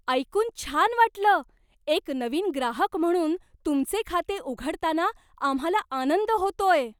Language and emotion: Marathi, surprised